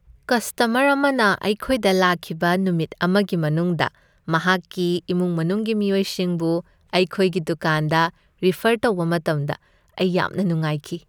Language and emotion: Manipuri, happy